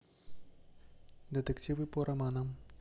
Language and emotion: Russian, neutral